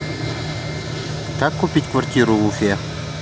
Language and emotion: Russian, neutral